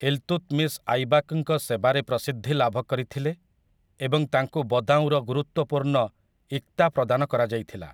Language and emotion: Odia, neutral